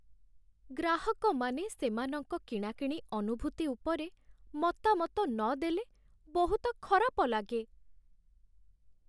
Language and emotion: Odia, sad